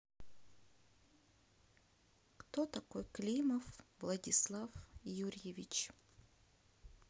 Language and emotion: Russian, sad